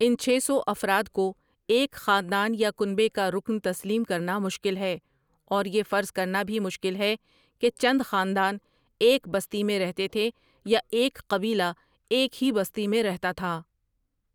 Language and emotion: Urdu, neutral